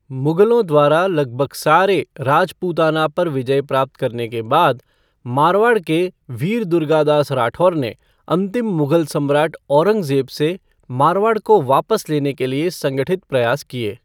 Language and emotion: Hindi, neutral